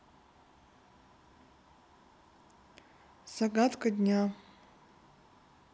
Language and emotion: Russian, neutral